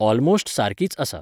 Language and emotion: Goan Konkani, neutral